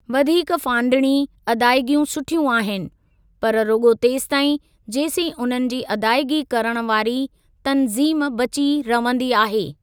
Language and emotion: Sindhi, neutral